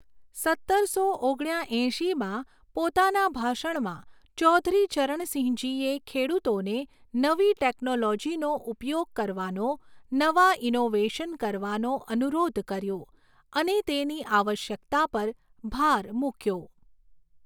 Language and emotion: Gujarati, neutral